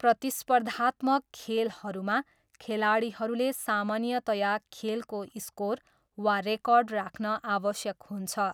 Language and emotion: Nepali, neutral